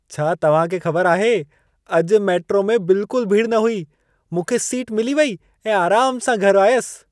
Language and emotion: Sindhi, happy